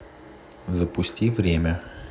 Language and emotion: Russian, neutral